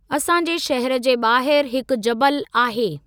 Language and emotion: Sindhi, neutral